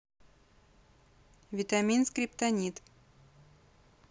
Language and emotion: Russian, neutral